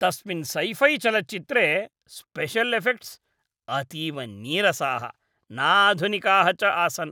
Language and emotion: Sanskrit, disgusted